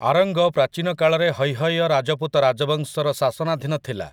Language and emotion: Odia, neutral